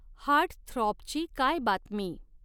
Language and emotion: Marathi, neutral